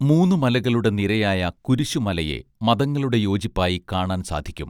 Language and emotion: Malayalam, neutral